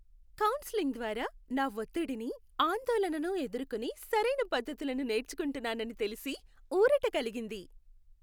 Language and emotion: Telugu, happy